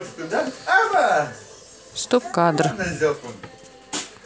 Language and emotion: Russian, neutral